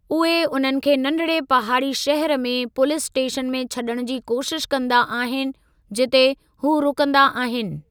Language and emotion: Sindhi, neutral